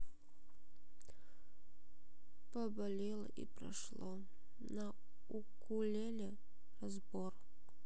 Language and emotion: Russian, sad